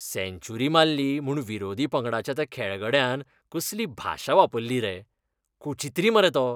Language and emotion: Goan Konkani, disgusted